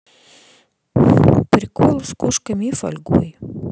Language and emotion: Russian, neutral